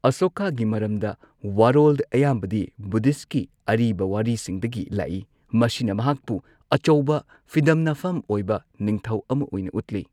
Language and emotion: Manipuri, neutral